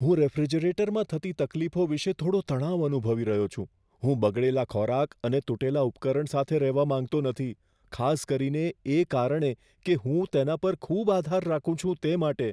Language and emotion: Gujarati, fearful